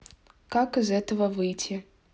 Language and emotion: Russian, neutral